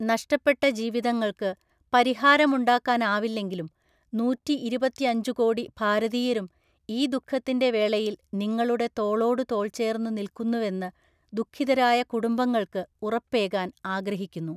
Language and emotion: Malayalam, neutral